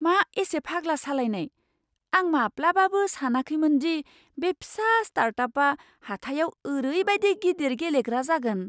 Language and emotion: Bodo, surprised